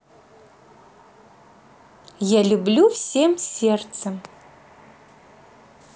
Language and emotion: Russian, positive